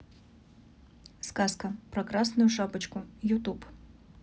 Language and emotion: Russian, neutral